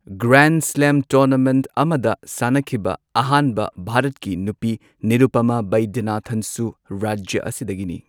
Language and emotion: Manipuri, neutral